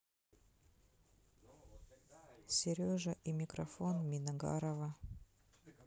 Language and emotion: Russian, neutral